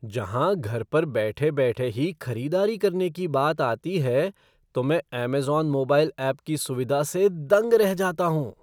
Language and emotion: Hindi, surprised